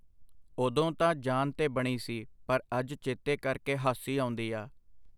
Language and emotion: Punjabi, neutral